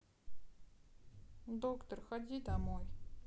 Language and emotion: Russian, sad